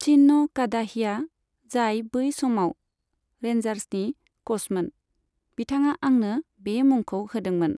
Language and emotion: Bodo, neutral